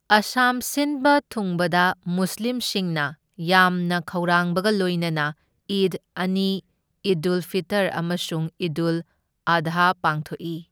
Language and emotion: Manipuri, neutral